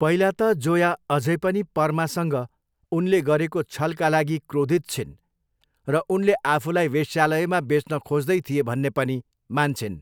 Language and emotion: Nepali, neutral